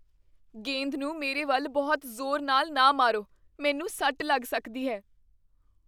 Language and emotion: Punjabi, fearful